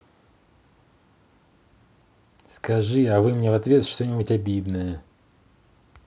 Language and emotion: Russian, neutral